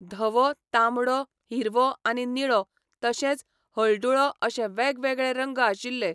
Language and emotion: Goan Konkani, neutral